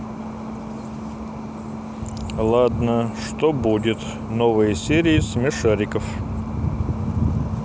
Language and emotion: Russian, neutral